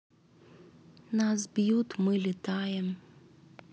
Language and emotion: Russian, neutral